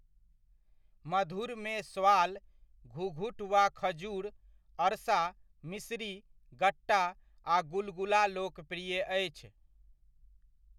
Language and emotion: Maithili, neutral